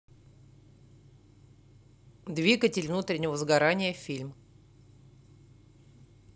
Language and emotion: Russian, neutral